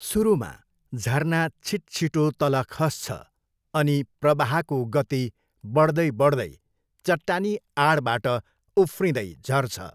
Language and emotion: Nepali, neutral